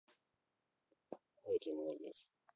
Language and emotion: Russian, positive